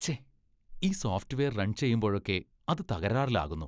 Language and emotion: Malayalam, disgusted